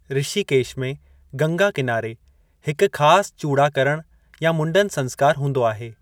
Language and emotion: Sindhi, neutral